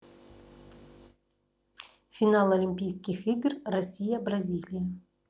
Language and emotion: Russian, neutral